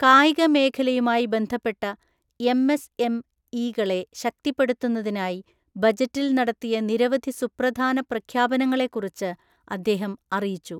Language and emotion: Malayalam, neutral